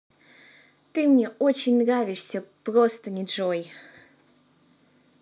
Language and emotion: Russian, positive